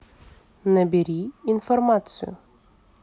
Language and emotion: Russian, neutral